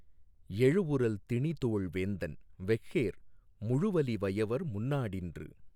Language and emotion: Tamil, neutral